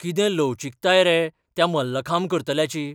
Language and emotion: Goan Konkani, surprised